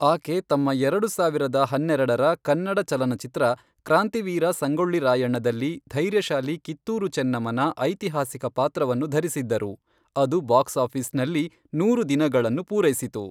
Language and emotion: Kannada, neutral